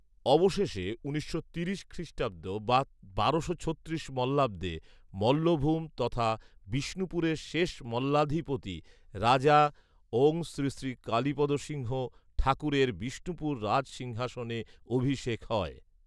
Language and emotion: Bengali, neutral